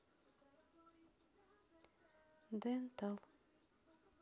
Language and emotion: Russian, neutral